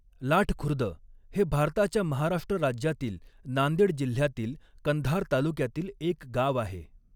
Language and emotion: Marathi, neutral